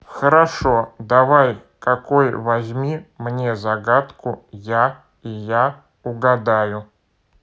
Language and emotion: Russian, neutral